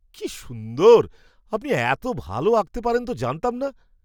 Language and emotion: Bengali, surprised